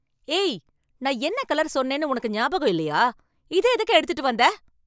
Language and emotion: Tamil, angry